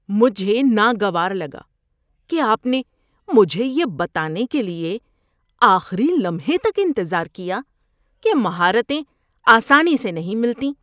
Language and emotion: Urdu, disgusted